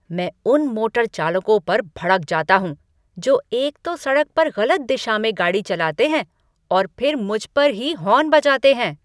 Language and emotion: Hindi, angry